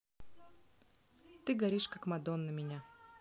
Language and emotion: Russian, neutral